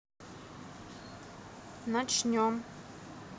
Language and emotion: Russian, neutral